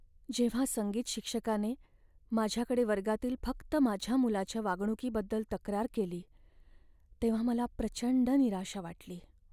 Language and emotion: Marathi, sad